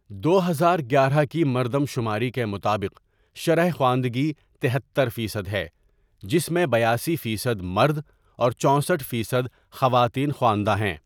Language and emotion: Urdu, neutral